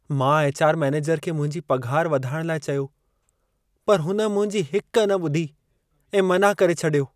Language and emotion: Sindhi, sad